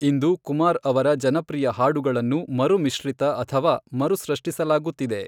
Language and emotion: Kannada, neutral